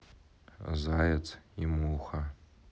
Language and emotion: Russian, neutral